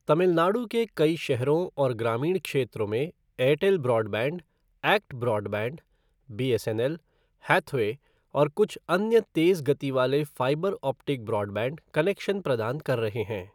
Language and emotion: Hindi, neutral